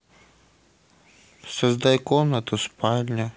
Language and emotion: Russian, sad